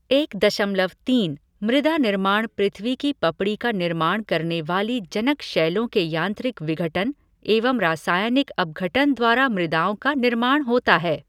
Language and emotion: Hindi, neutral